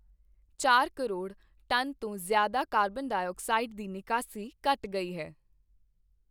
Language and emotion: Punjabi, neutral